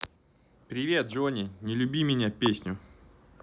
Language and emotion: Russian, positive